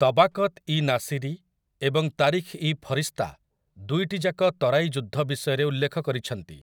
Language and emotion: Odia, neutral